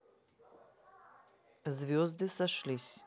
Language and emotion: Russian, neutral